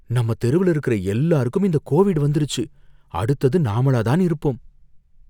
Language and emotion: Tamil, fearful